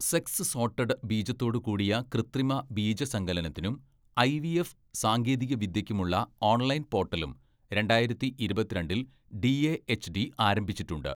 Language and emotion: Malayalam, neutral